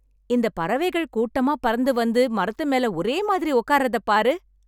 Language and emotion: Tamil, happy